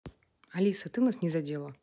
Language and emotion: Russian, neutral